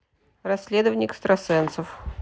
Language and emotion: Russian, neutral